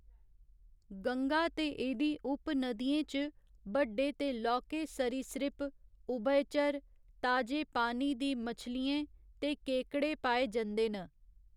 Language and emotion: Dogri, neutral